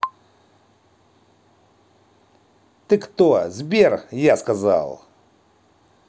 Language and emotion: Russian, angry